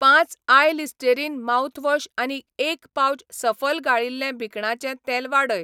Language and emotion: Goan Konkani, neutral